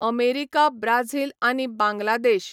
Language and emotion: Goan Konkani, neutral